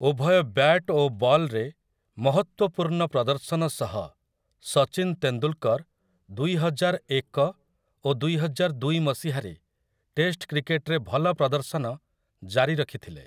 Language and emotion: Odia, neutral